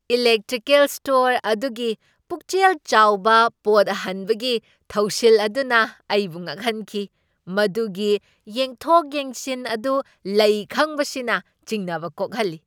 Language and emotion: Manipuri, surprised